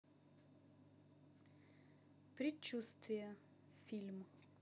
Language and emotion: Russian, neutral